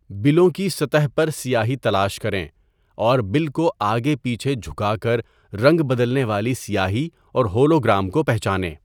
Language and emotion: Urdu, neutral